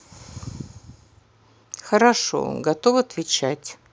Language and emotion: Russian, neutral